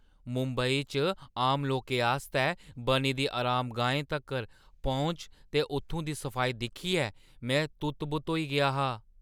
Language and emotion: Dogri, surprised